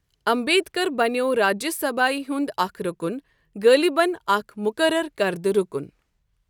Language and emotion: Kashmiri, neutral